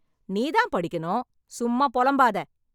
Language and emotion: Tamil, angry